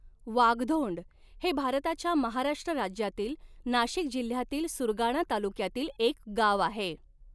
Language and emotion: Marathi, neutral